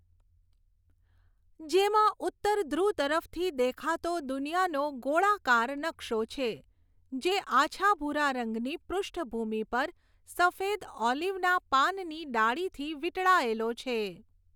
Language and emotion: Gujarati, neutral